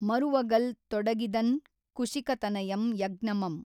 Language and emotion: Kannada, neutral